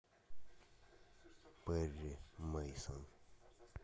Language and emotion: Russian, neutral